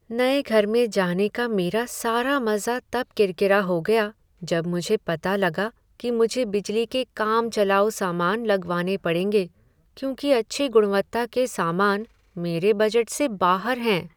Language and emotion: Hindi, sad